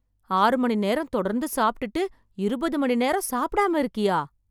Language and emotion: Tamil, surprised